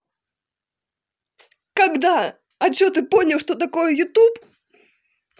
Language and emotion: Russian, angry